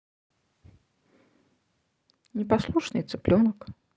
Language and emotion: Russian, neutral